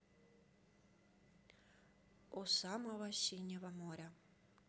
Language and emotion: Russian, neutral